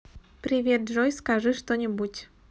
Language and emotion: Russian, neutral